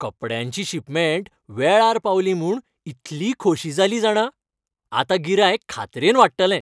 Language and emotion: Goan Konkani, happy